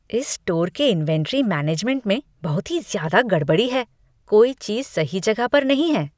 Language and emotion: Hindi, disgusted